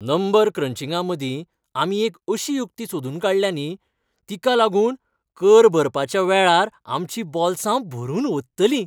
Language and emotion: Goan Konkani, happy